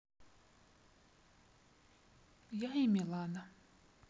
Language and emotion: Russian, neutral